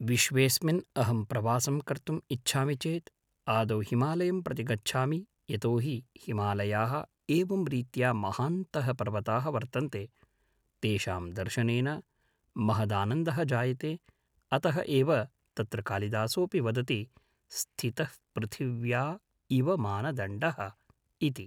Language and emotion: Sanskrit, neutral